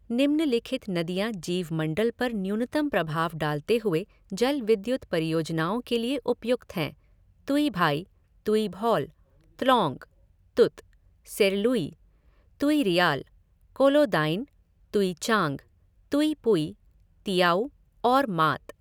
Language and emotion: Hindi, neutral